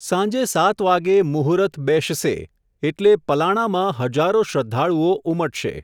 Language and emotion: Gujarati, neutral